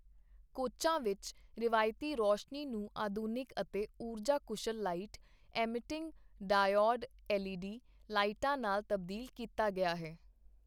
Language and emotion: Punjabi, neutral